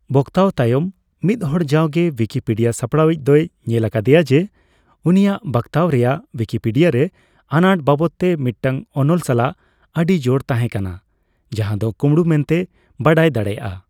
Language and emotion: Santali, neutral